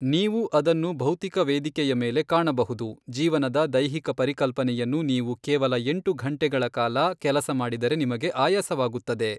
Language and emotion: Kannada, neutral